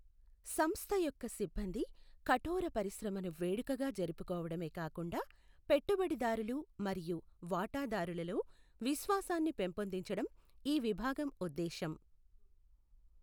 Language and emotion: Telugu, neutral